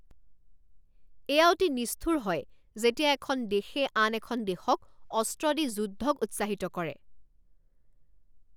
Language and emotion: Assamese, angry